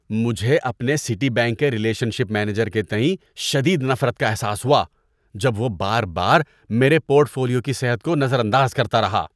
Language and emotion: Urdu, disgusted